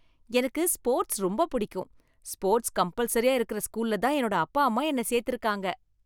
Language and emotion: Tamil, happy